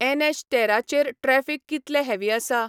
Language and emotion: Goan Konkani, neutral